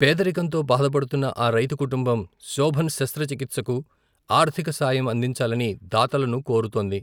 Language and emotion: Telugu, neutral